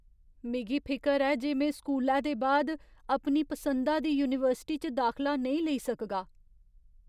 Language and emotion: Dogri, fearful